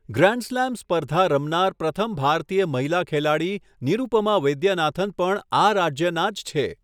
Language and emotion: Gujarati, neutral